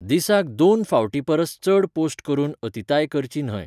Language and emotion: Goan Konkani, neutral